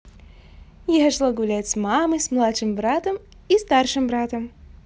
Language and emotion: Russian, positive